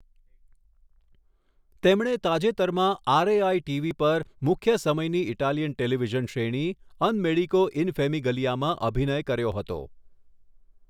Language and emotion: Gujarati, neutral